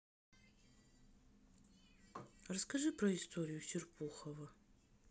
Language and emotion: Russian, neutral